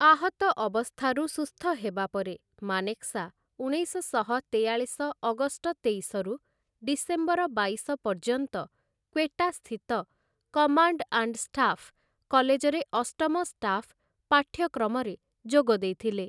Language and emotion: Odia, neutral